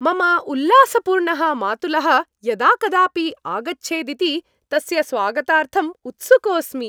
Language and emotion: Sanskrit, happy